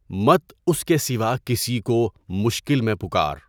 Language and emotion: Urdu, neutral